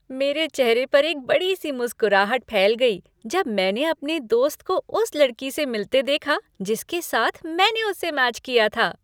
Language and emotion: Hindi, happy